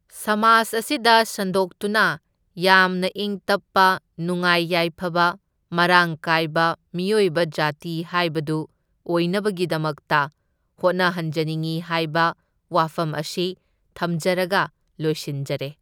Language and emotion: Manipuri, neutral